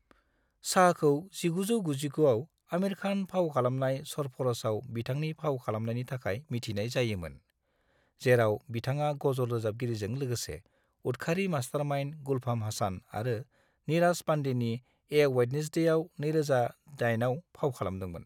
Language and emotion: Bodo, neutral